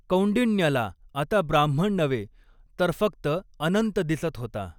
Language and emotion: Marathi, neutral